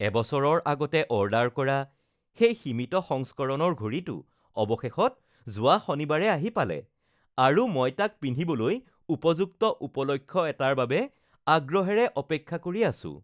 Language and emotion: Assamese, happy